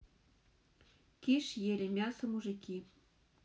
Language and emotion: Russian, neutral